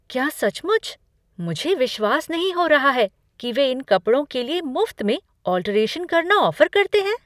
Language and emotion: Hindi, surprised